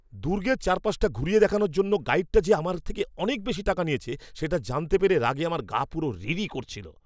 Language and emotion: Bengali, angry